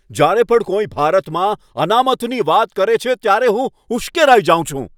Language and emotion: Gujarati, angry